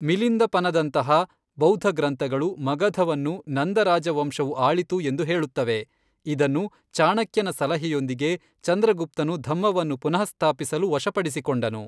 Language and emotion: Kannada, neutral